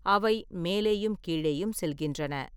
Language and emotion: Tamil, neutral